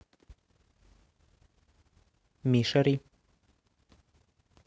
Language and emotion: Russian, neutral